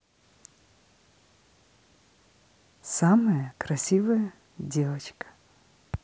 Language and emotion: Russian, positive